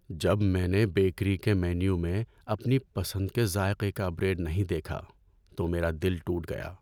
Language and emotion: Urdu, sad